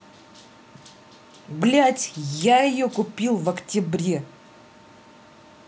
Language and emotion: Russian, angry